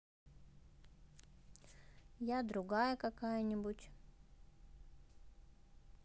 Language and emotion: Russian, neutral